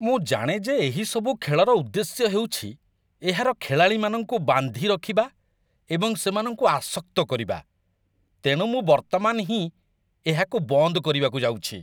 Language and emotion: Odia, disgusted